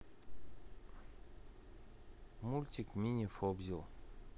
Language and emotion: Russian, neutral